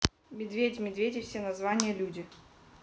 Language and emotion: Russian, neutral